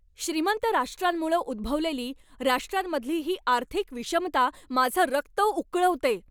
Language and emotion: Marathi, angry